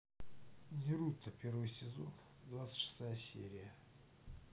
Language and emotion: Russian, neutral